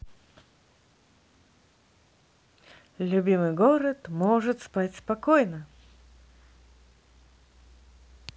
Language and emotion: Russian, positive